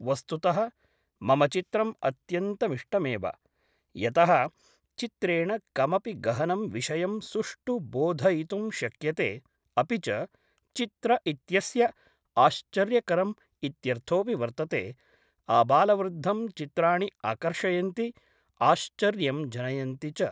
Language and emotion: Sanskrit, neutral